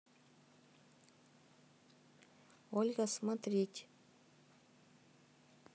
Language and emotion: Russian, neutral